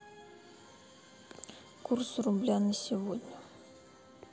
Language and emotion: Russian, neutral